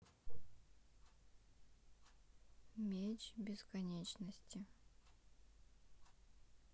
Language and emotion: Russian, neutral